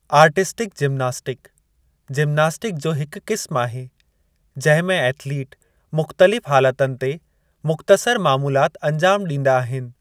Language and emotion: Sindhi, neutral